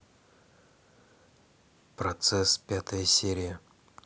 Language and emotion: Russian, neutral